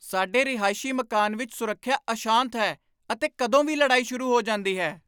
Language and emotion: Punjabi, angry